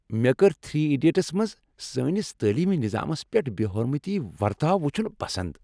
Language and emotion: Kashmiri, happy